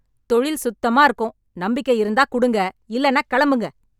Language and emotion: Tamil, angry